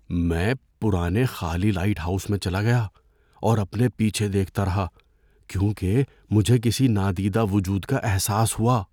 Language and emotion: Urdu, fearful